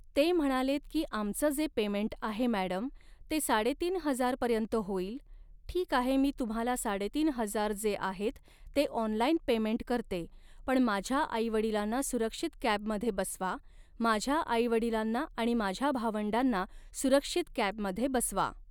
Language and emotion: Marathi, neutral